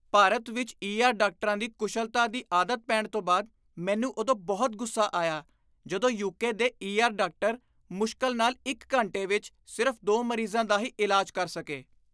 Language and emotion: Punjabi, disgusted